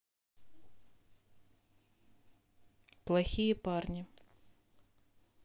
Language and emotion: Russian, neutral